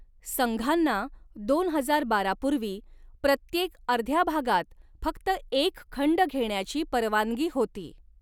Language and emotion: Marathi, neutral